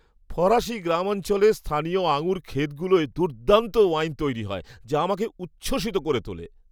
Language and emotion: Bengali, happy